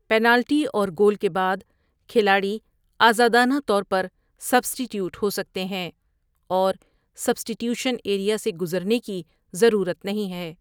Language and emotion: Urdu, neutral